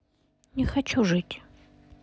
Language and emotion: Russian, sad